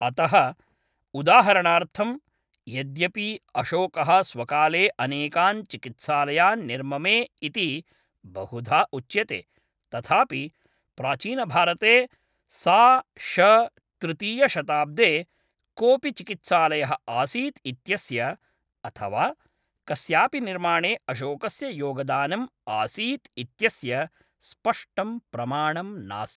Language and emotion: Sanskrit, neutral